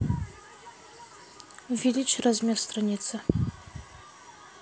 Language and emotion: Russian, neutral